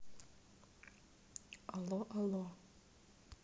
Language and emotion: Russian, neutral